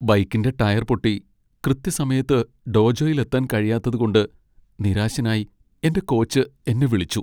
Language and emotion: Malayalam, sad